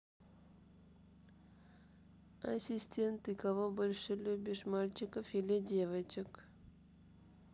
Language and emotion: Russian, neutral